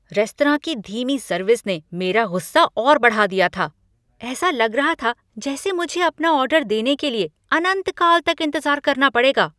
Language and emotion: Hindi, angry